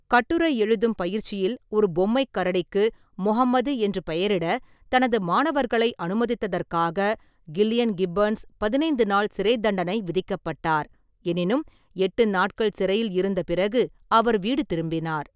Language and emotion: Tamil, neutral